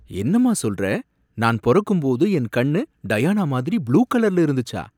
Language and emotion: Tamil, surprised